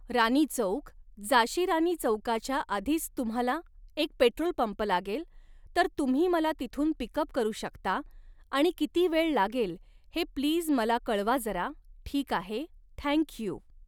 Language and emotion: Marathi, neutral